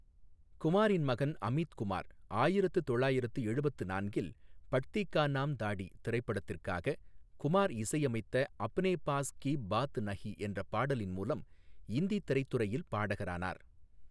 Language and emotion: Tamil, neutral